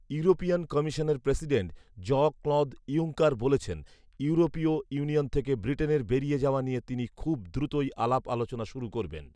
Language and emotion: Bengali, neutral